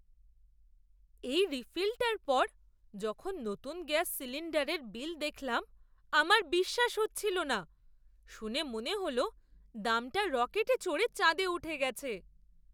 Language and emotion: Bengali, surprised